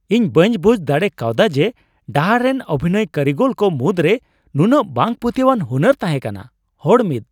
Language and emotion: Santali, surprised